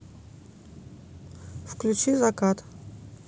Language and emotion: Russian, neutral